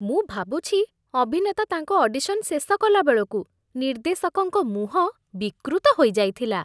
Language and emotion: Odia, disgusted